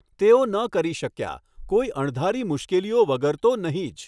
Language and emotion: Gujarati, neutral